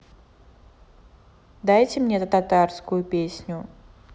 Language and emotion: Russian, neutral